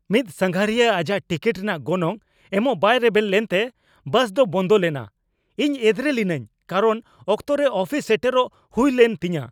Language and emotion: Santali, angry